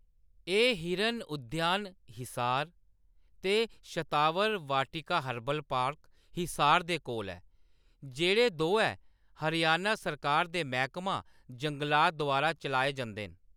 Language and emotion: Dogri, neutral